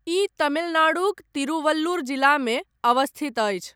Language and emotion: Maithili, neutral